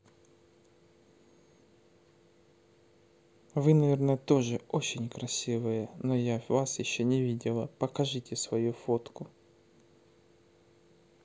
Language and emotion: Russian, neutral